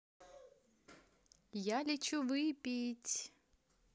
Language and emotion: Russian, positive